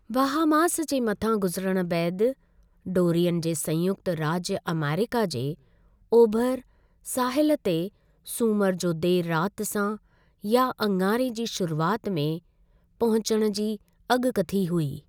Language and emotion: Sindhi, neutral